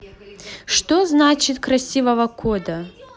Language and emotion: Russian, positive